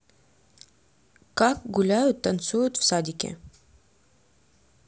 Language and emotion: Russian, neutral